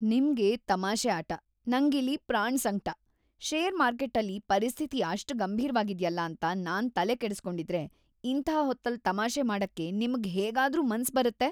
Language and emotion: Kannada, disgusted